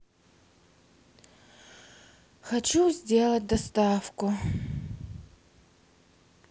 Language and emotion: Russian, sad